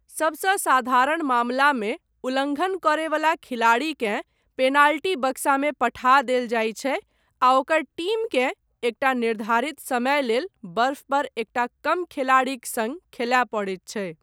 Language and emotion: Maithili, neutral